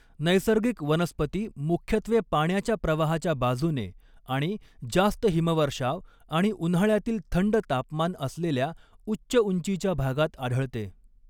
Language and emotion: Marathi, neutral